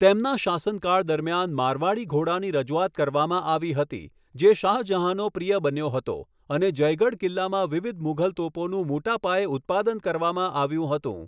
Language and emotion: Gujarati, neutral